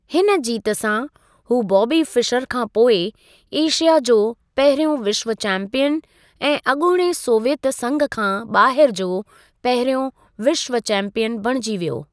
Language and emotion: Sindhi, neutral